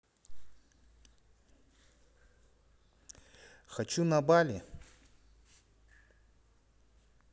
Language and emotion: Russian, neutral